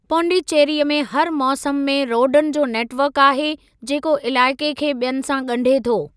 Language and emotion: Sindhi, neutral